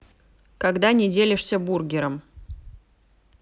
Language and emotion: Russian, neutral